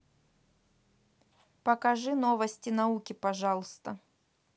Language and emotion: Russian, neutral